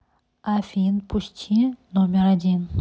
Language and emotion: Russian, neutral